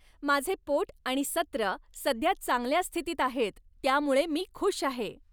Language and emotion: Marathi, happy